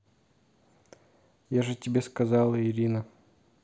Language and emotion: Russian, neutral